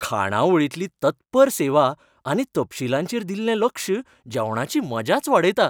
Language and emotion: Goan Konkani, happy